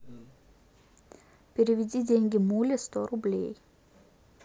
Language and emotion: Russian, neutral